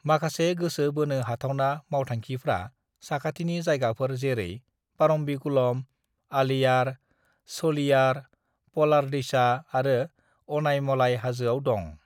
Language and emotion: Bodo, neutral